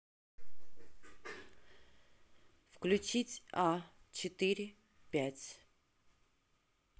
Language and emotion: Russian, neutral